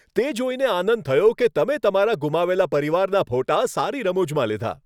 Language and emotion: Gujarati, happy